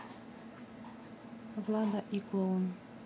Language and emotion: Russian, neutral